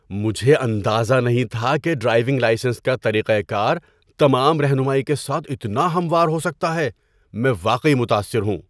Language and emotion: Urdu, surprised